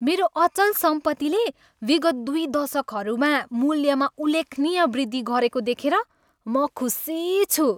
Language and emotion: Nepali, happy